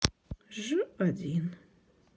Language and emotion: Russian, sad